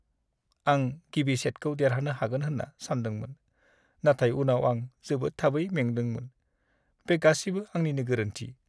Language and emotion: Bodo, sad